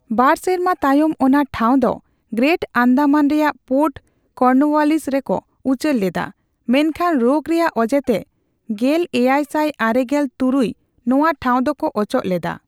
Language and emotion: Santali, neutral